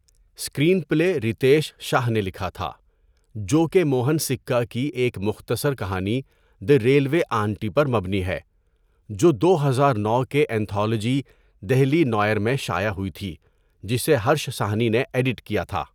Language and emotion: Urdu, neutral